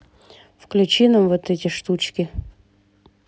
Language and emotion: Russian, neutral